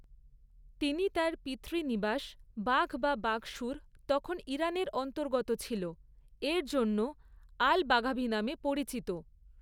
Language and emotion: Bengali, neutral